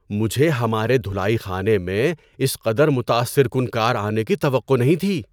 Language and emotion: Urdu, surprised